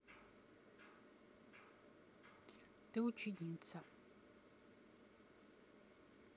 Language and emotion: Russian, neutral